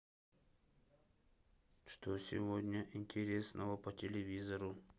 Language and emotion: Russian, neutral